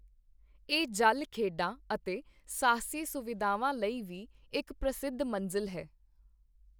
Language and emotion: Punjabi, neutral